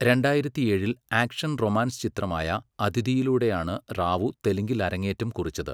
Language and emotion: Malayalam, neutral